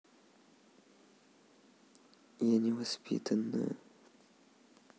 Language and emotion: Russian, sad